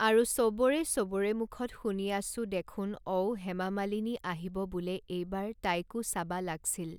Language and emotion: Assamese, neutral